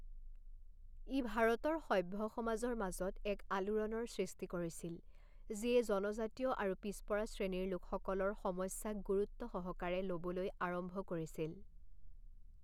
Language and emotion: Assamese, neutral